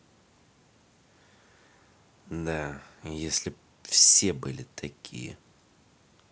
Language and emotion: Russian, angry